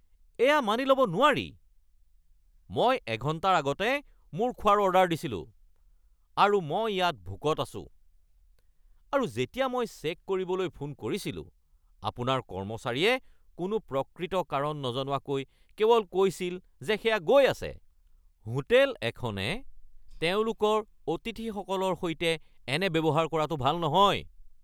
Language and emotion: Assamese, angry